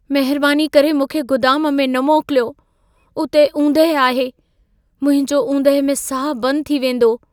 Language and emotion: Sindhi, fearful